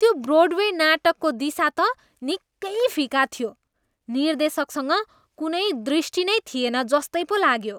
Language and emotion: Nepali, disgusted